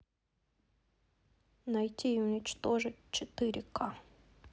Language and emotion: Russian, neutral